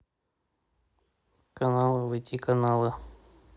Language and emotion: Russian, neutral